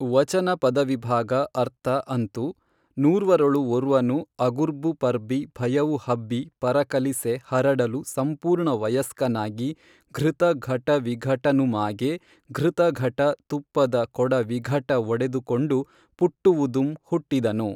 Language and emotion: Kannada, neutral